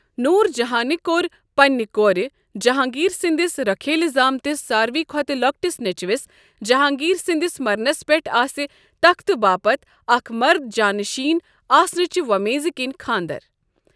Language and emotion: Kashmiri, neutral